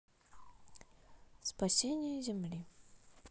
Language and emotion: Russian, neutral